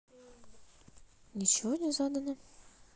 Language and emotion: Russian, neutral